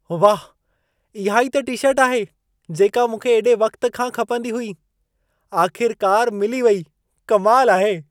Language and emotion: Sindhi, surprised